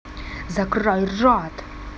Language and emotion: Russian, angry